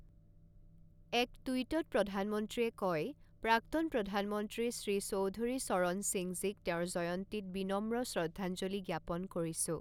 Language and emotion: Assamese, neutral